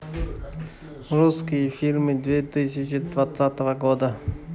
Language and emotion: Russian, neutral